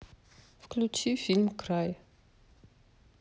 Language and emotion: Russian, neutral